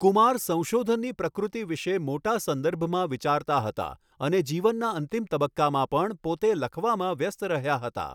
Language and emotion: Gujarati, neutral